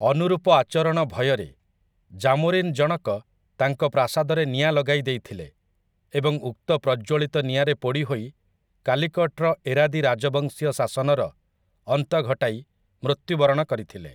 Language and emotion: Odia, neutral